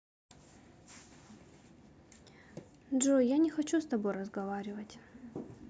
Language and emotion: Russian, sad